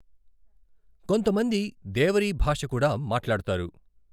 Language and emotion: Telugu, neutral